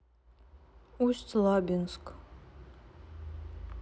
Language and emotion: Russian, neutral